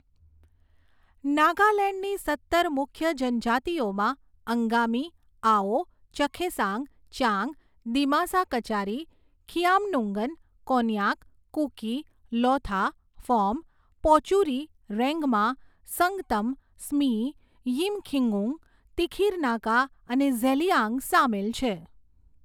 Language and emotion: Gujarati, neutral